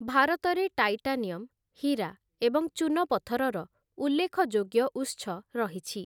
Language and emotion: Odia, neutral